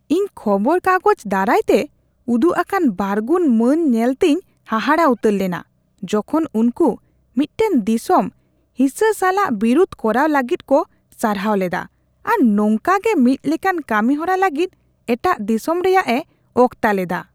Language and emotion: Santali, disgusted